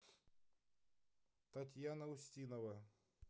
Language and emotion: Russian, neutral